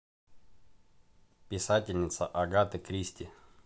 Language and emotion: Russian, neutral